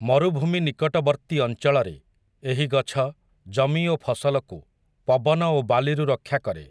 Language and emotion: Odia, neutral